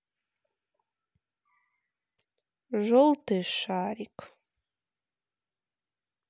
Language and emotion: Russian, sad